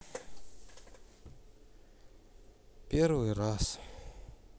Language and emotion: Russian, sad